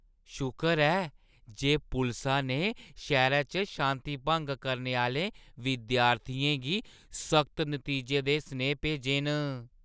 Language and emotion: Dogri, happy